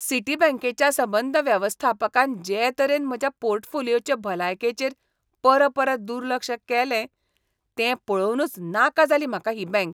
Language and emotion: Goan Konkani, disgusted